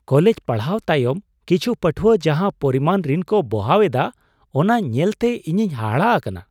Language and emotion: Santali, surprised